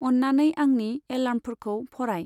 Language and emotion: Bodo, neutral